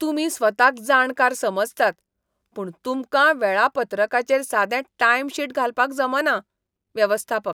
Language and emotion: Goan Konkani, disgusted